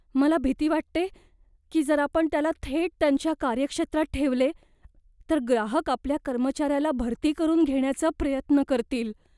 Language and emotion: Marathi, fearful